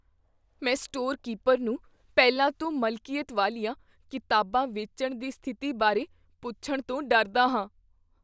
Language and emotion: Punjabi, fearful